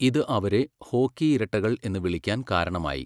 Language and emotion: Malayalam, neutral